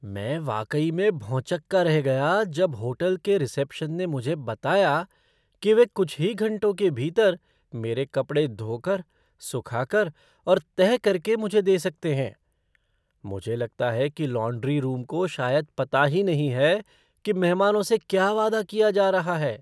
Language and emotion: Hindi, surprised